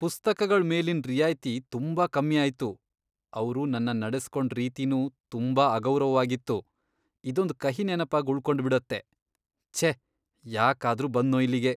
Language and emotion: Kannada, disgusted